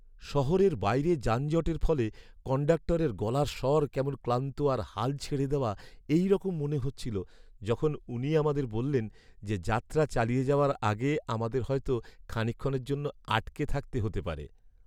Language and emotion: Bengali, sad